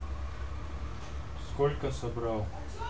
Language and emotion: Russian, neutral